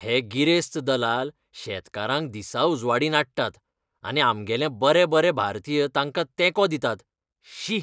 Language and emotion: Goan Konkani, disgusted